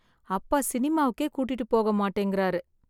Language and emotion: Tamil, sad